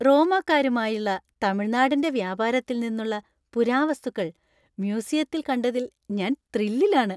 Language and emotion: Malayalam, happy